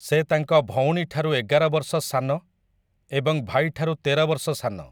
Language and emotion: Odia, neutral